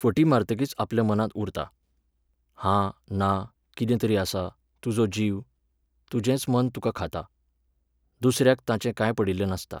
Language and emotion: Goan Konkani, neutral